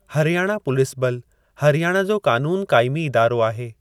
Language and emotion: Sindhi, neutral